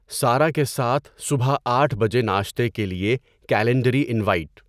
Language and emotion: Urdu, neutral